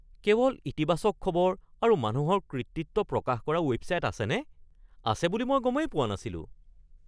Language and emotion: Assamese, surprised